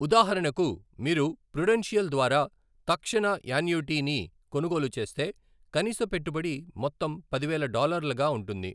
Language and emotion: Telugu, neutral